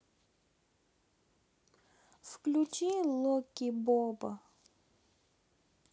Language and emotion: Russian, neutral